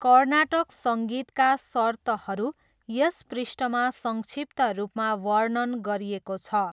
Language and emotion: Nepali, neutral